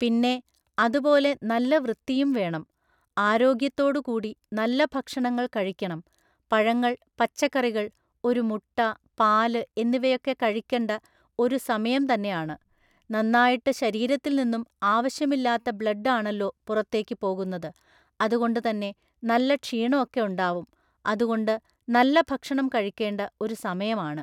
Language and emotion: Malayalam, neutral